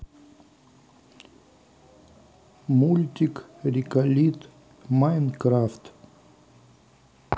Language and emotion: Russian, neutral